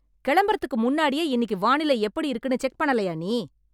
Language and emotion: Tamil, angry